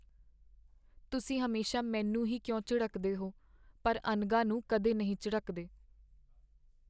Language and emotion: Punjabi, sad